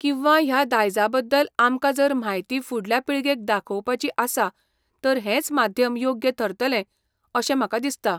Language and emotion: Goan Konkani, neutral